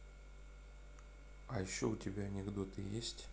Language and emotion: Russian, neutral